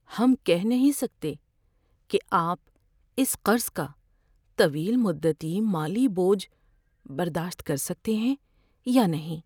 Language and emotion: Urdu, fearful